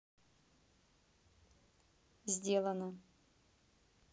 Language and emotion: Russian, neutral